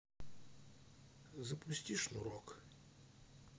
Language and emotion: Russian, neutral